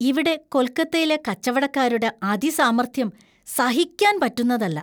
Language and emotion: Malayalam, disgusted